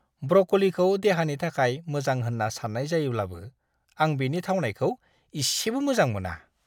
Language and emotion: Bodo, disgusted